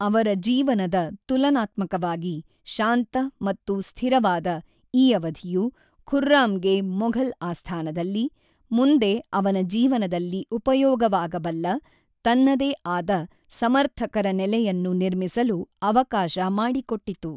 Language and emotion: Kannada, neutral